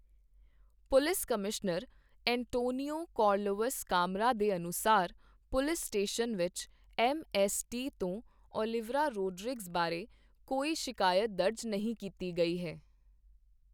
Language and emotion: Punjabi, neutral